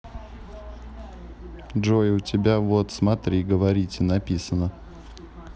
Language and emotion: Russian, neutral